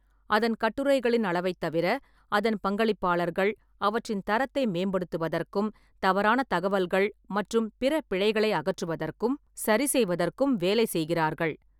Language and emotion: Tamil, neutral